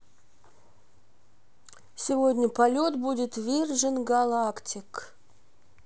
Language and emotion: Russian, neutral